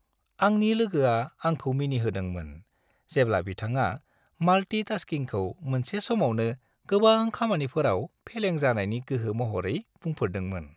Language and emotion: Bodo, happy